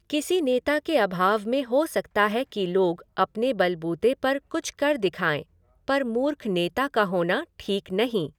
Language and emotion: Hindi, neutral